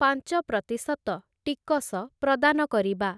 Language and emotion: Odia, neutral